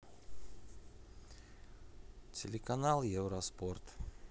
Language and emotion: Russian, neutral